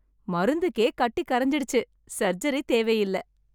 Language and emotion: Tamil, happy